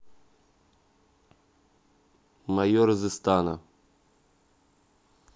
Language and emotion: Russian, neutral